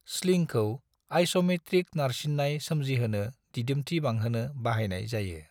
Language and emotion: Bodo, neutral